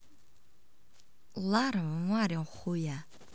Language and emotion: Russian, neutral